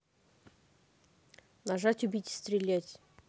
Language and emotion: Russian, neutral